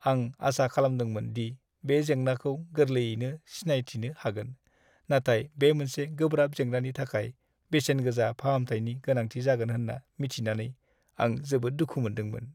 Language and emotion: Bodo, sad